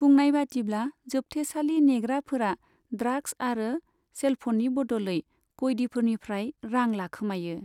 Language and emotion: Bodo, neutral